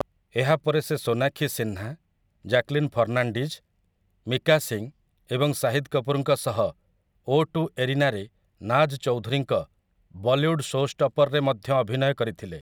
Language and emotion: Odia, neutral